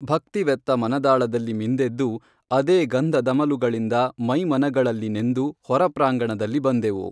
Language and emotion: Kannada, neutral